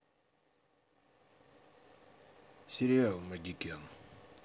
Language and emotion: Russian, neutral